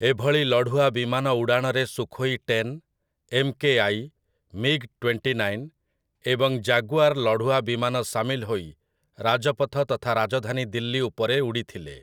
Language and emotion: Odia, neutral